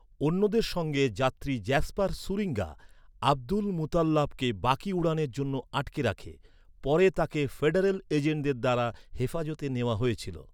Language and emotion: Bengali, neutral